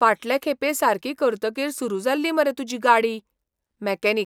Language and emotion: Goan Konkani, surprised